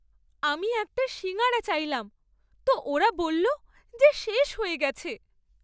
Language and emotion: Bengali, sad